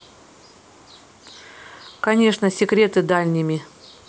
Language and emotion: Russian, neutral